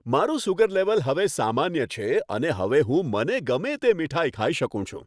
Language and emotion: Gujarati, happy